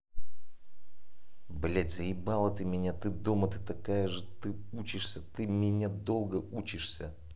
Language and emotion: Russian, angry